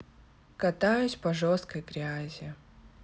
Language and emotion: Russian, sad